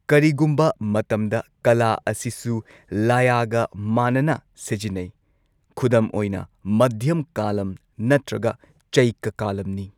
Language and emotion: Manipuri, neutral